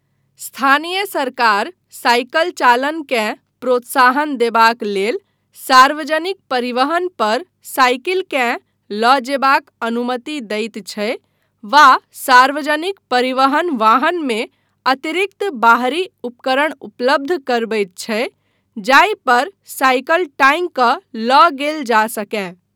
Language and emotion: Maithili, neutral